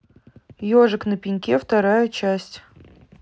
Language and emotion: Russian, neutral